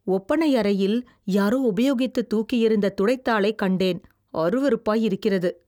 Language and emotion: Tamil, disgusted